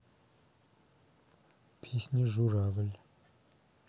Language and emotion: Russian, neutral